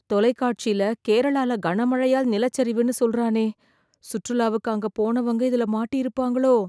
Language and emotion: Tamil, fearful